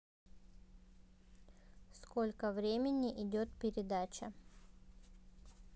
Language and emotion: Russian, neutral